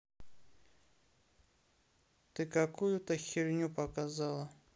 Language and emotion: Russian, neutral